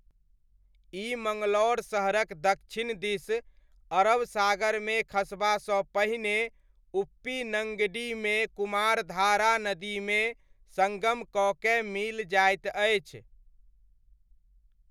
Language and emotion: Maithili, neutral